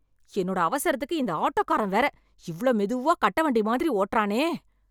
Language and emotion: Tamil, angry